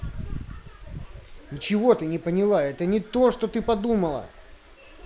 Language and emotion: Russian, angry